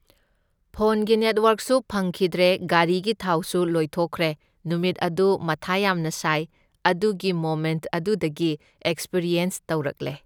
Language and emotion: Manipuri, neutral